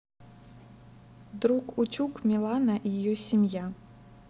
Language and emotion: Russian, neutral